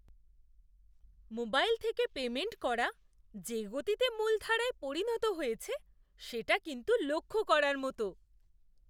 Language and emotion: Bengali, surprised